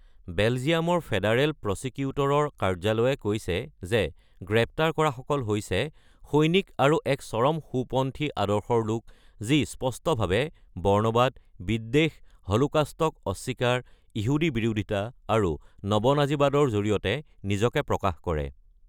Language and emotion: Assamese, neutral